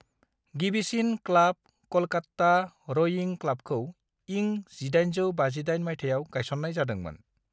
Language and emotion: Bodo, neutral